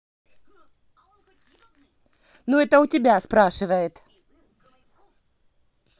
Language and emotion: Russian, angry